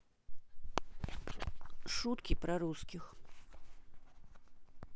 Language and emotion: Russian, neutral